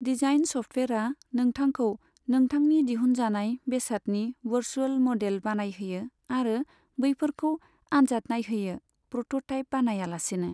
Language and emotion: Bodo, neutral